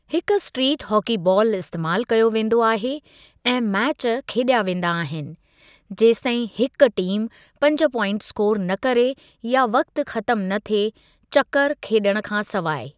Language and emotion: Sindhi, neutral